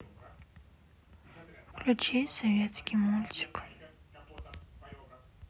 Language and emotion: Russian, sad